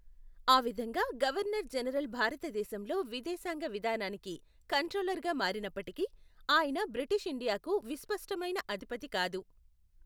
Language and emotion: Telugu, neutral